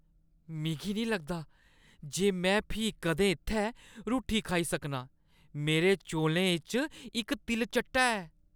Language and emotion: Dogri, disgusted